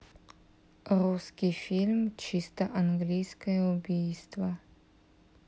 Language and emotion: Russian, neutral